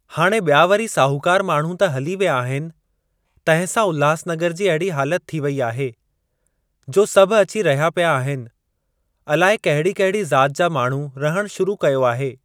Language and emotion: Sindhi, neutral